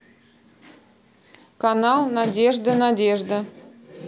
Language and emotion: Russian, neutral